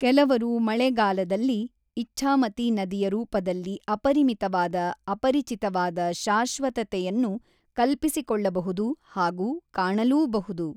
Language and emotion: Kannada, neutral